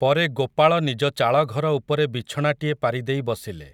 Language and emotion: Odia, neutral